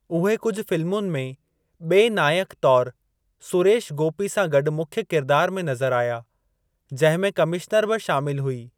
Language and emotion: Sindhi, neutral